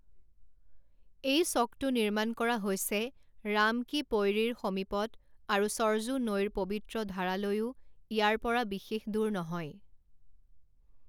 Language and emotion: Assamese, neutral